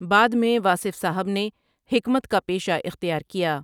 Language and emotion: Urdu, neutral